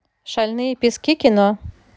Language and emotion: Russian, positive